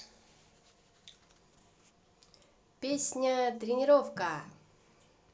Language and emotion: Russian, positive